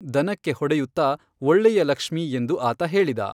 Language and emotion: Kannada, neutral